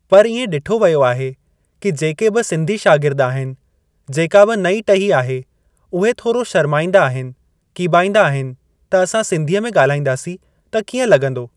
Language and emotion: Sindhi, neutral